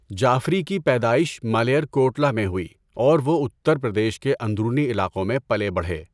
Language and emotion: Urdu, neutral